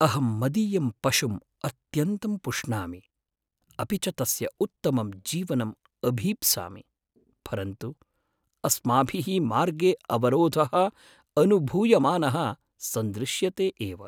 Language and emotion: Sanskrit, sad